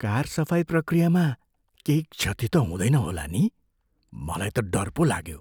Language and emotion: Nepali, fearful